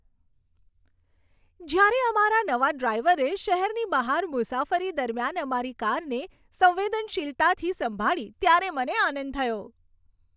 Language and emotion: Gujarati, happy